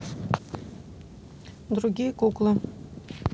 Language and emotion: Russian, neutral